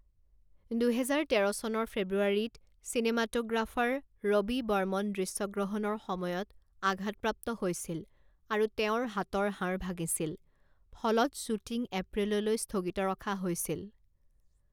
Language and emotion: Assamese, neutral